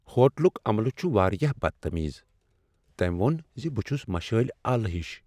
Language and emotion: Kashmiri, sad